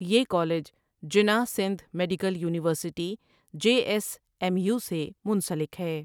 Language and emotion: Urdu, neutral